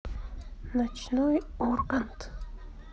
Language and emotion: Russian, neutral